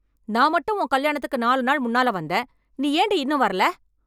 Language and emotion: Tamil, angry